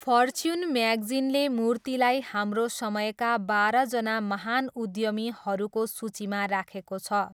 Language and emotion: Nepali, neutral